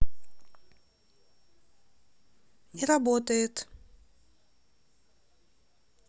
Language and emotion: Russian, neutral